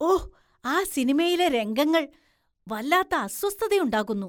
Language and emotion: Malayalam, disgusted